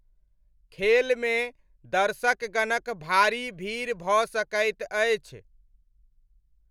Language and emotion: Maithili, neutral